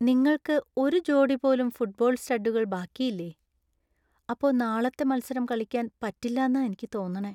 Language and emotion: Malayalam, sad